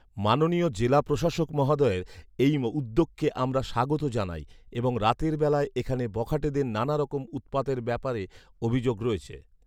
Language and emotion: Bengali, neutral